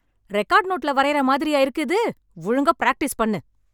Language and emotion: Tamil, angry